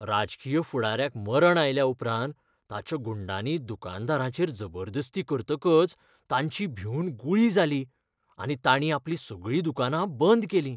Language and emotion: Goan Konkani, fearful